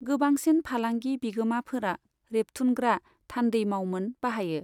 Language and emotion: Bodo, neutral